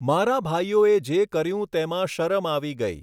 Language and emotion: Gujarati, neutral